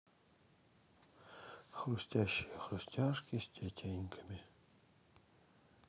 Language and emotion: Russian, sad